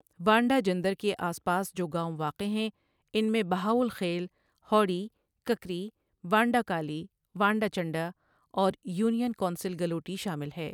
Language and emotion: Urdu, neutral